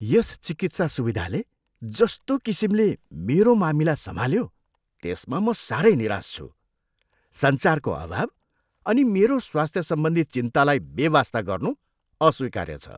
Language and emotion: Nepali, disgusted